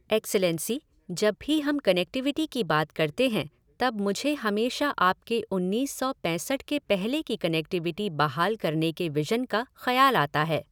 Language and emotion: Hindi, neutral